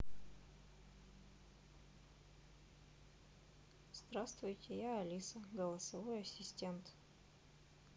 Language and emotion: Russian, neutral